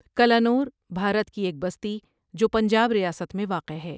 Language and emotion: Urdu, neutral